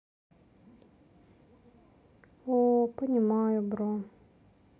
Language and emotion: Russian, sad